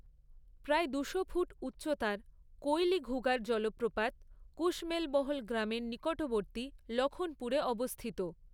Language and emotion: Bengali, neutral